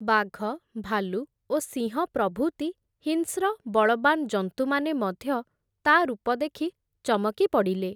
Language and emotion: Odia, neutral